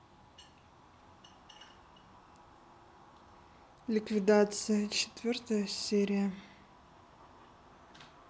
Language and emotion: Russian, neutral